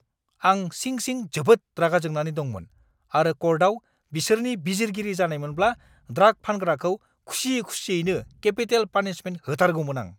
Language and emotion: Bodo, angry